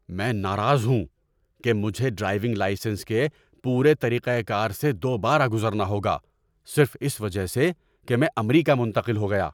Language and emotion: Urdu, angry